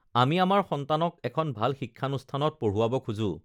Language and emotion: Assamese, neutral